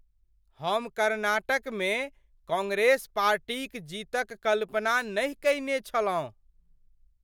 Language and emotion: Maithili, surprised